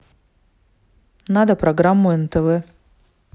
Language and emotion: Russian, neutral